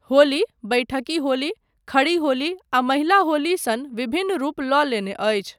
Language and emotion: Maithili, neutral